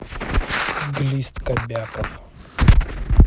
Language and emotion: Russian, neutral